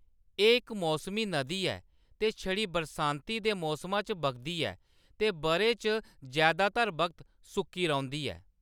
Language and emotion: Dogri, neutral